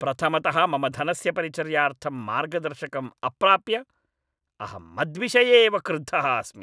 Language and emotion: Sanskrit, angry